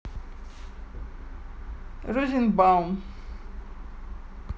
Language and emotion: Russian, neutral